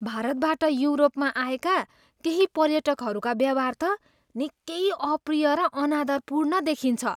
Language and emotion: Nepali, disgusted